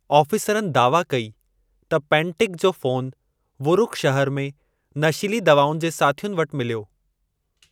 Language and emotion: Sindhi, neutral